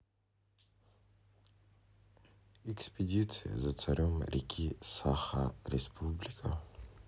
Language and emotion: Russian, sad